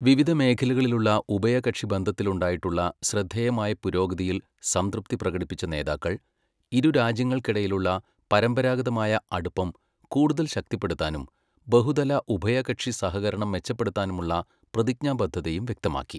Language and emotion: Malayalam, neutral